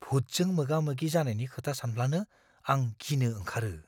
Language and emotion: Bodo, fearful